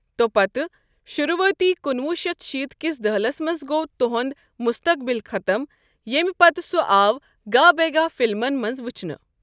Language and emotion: Kashmiri, neutral